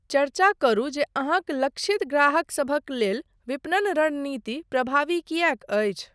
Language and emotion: Maithili, neutral